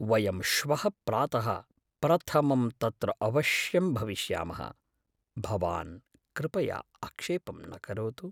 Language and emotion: Sanskrit, fearful